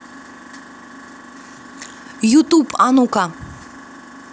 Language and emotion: Russian, positive